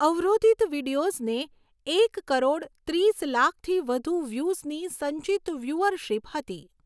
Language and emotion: Gujarati, neutral